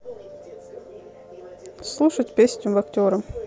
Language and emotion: Russian, neutral